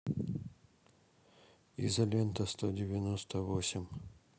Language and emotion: Russian, neutral